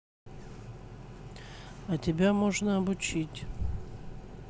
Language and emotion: Russian, neutral